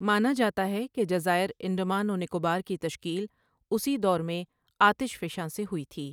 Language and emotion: Urdu, neutral